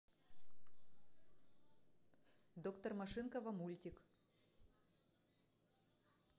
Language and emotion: Russian, neutral